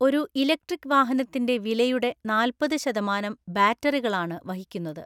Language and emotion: Malayalam, neutral